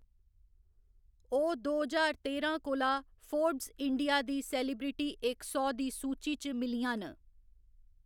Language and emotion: Dogri, neutral